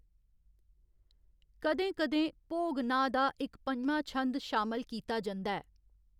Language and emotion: Dogri, neutral